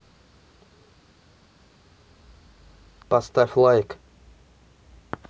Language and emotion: Russian, neutral